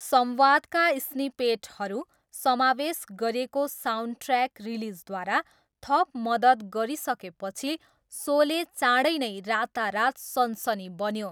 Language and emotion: Nepali, neutral